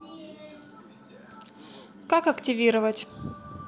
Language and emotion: Russian, neutral